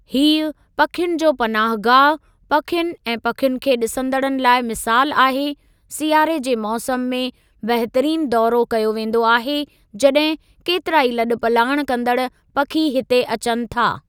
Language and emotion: Sindhi, neutral